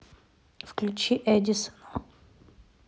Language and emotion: Russian, neutral